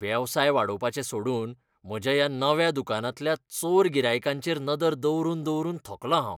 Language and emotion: Goan Konkani, disgusted